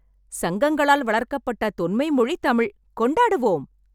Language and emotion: Tamil, happy